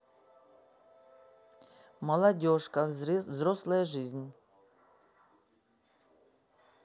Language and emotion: Russian, neutral